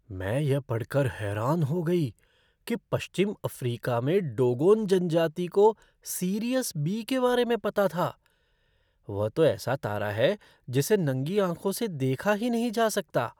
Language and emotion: Hindi, surprised